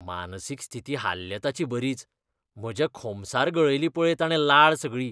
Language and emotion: Goan Konkani, disgusted